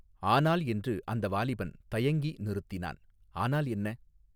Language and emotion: Tamil, neutral